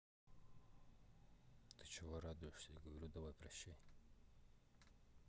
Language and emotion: Russian, neutral